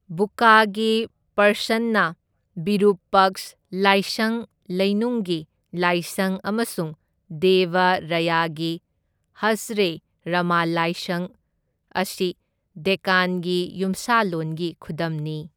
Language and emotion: Manipuri, neutral